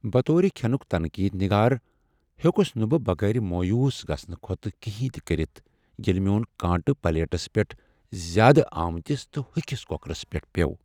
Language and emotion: Kashmiri, sad